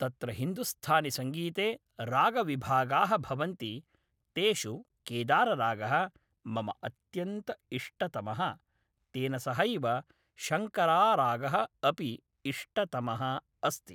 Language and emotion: Sanskrit, neutral